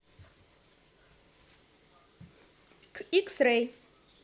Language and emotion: Russian, positive